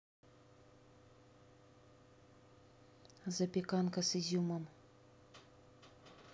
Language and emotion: Russian, neutral